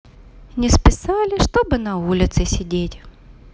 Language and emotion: Russian, positive